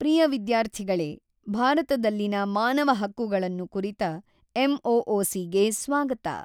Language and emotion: Kannada, neutral